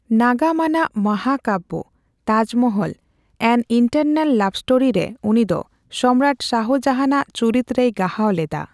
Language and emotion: Santali, neutral